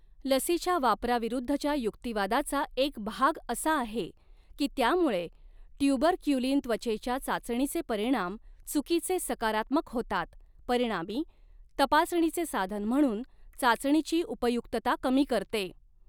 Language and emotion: Marathi, neutral